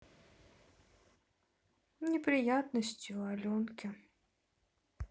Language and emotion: Russian, sad